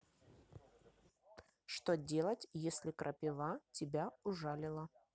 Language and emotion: Russian, neutral